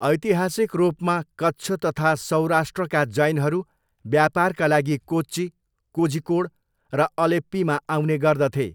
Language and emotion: Nepali, neutral